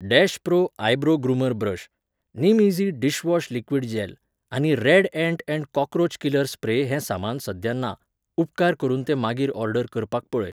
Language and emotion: Goan Konkani, neutral